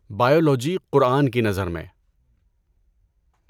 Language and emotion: Urdu, neutral